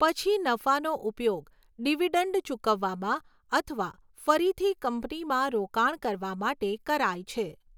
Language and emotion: Gujarati, neutral